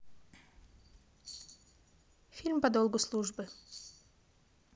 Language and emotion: Russian, neutral